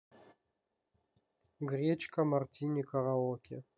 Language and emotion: Russian, neutral